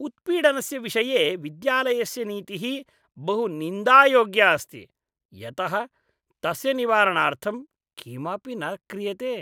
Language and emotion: Sanskrit, disgusted